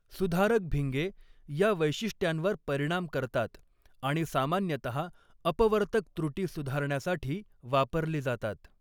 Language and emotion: Marathi, neutral